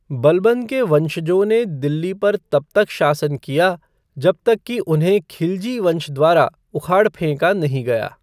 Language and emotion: Hindi, neutral